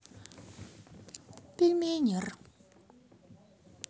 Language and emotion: Russian, sad